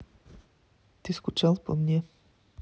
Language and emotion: Russian, neutral